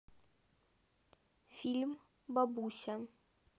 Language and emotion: Russian, neutral